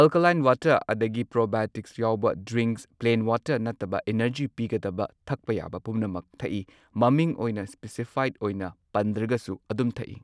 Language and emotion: Manipuri, neutral